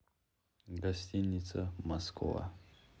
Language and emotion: Russian, neutral